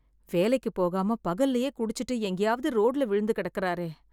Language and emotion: Tamil, sad